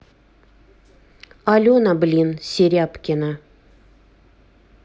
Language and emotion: Russian, angry